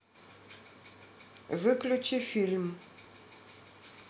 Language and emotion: Russian, neutral